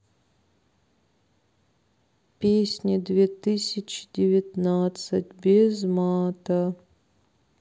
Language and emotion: Russian, sad